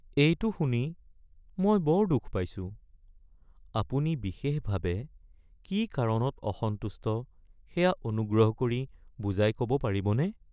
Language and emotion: Assamese, sad